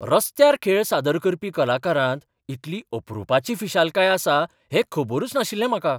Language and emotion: Goan Konkani, surprised